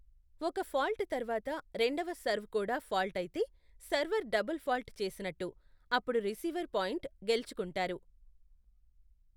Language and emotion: Telugu, neutral